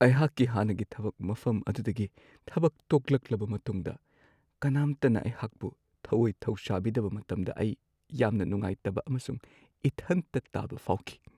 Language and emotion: Manipuri, sad